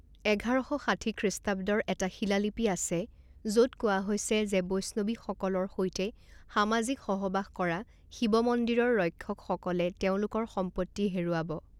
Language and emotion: Assamese, neutral